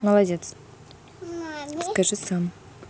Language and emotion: Russian, neutral